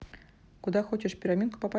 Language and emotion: Russian, neutral